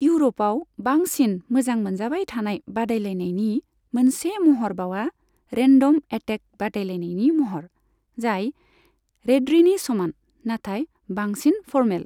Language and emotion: Bodo, neutral